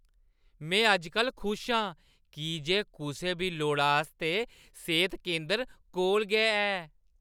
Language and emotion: Dogri, happy